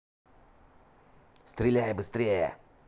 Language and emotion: Russian, angry